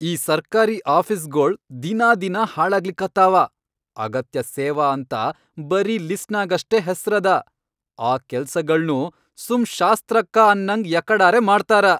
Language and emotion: Kannada, angry